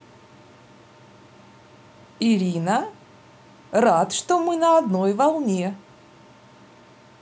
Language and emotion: Russian, positive